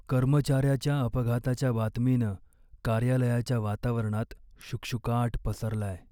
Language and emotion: Marathi, sad